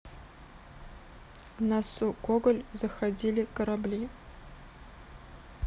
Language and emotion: Russian, neutral